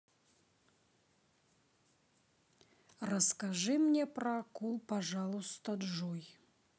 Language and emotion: Russian, neutral